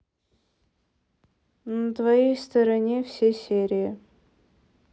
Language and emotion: Russian, neutral